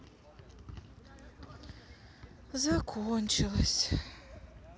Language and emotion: Russian, sad